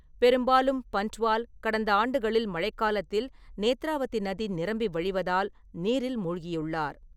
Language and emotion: Tamil, neutral